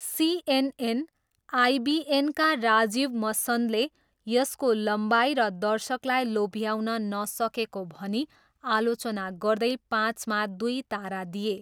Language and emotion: Nepali, neutral